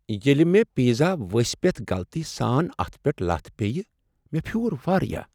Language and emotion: Kashmiri, sad